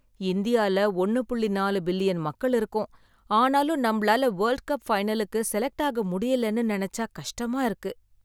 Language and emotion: Tamil, sad